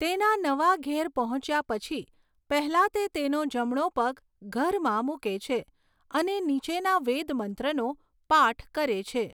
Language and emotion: Gujarati, neutral